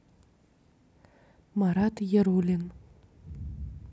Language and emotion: Russian, neutral